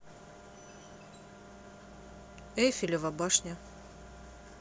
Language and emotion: Russian, neutral